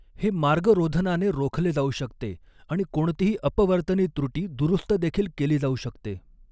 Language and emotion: Marathi, neutral